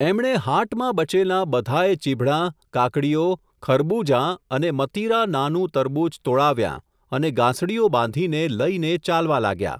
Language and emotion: Gujarati, neutral